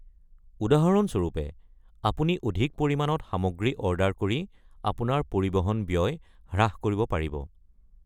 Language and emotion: Assamese, neutral